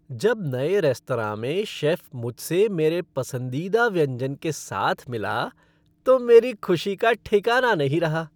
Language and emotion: Hindi, happy